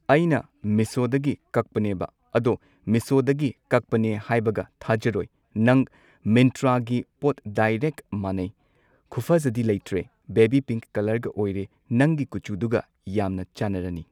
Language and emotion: Manipuri, neutral